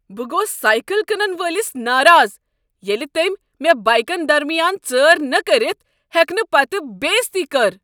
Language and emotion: Kashmiri, angry